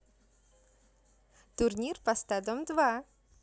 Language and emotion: Russian, positive